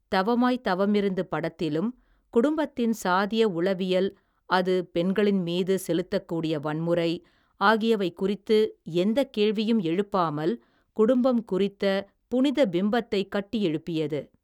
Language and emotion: Tamil, neutral